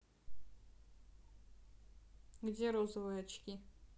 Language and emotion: Russian, neutral